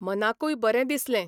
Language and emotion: Goan Konkani, neutral